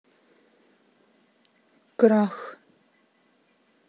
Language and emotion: Russian, neutral